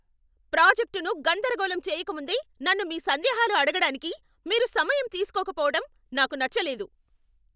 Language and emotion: Telugu, angry